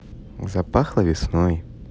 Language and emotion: Russian, positive